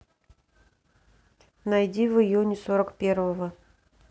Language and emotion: Russian, neutral